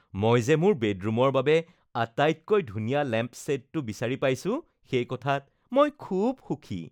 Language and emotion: Assamese, happy